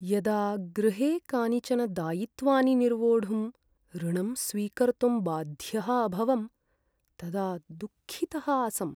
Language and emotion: Sanskrit, sad